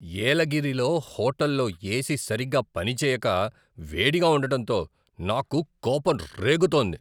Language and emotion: Telugu, angry